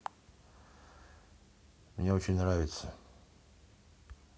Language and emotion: Russian, neutral